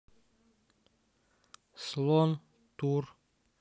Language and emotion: Russian, neutral